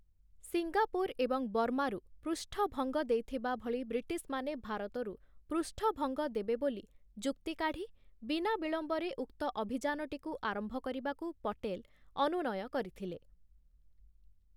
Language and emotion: Odia, neutral